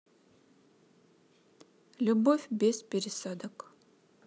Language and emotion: Russian, neutral